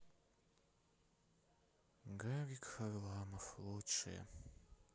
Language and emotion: Russian, sad